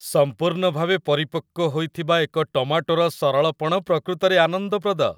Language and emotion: Odia, happy